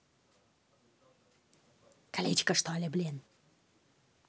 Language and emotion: Russian, angry